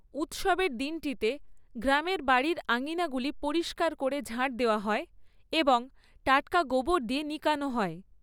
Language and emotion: Bengali, neutral